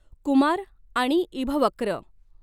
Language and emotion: Marathi, neutral